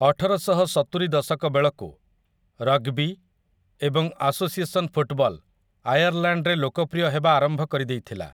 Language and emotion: Odia, neutral